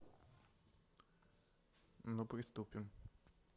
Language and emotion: Russian, neutral